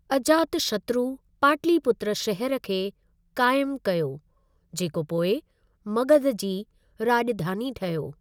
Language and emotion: Sindhi, neutral